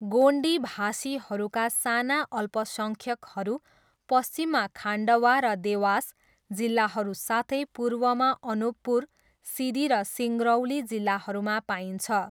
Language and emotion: Nepali, neutral